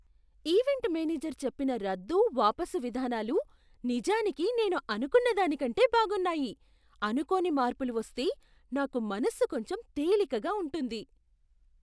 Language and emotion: Telugu, surprised